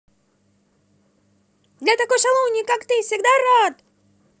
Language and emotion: Russian, positive